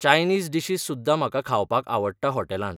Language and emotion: Goan Konkani, neutral